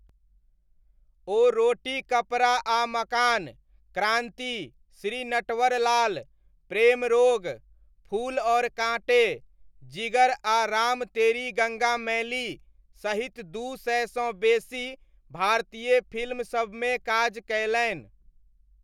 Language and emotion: Maithili, neutral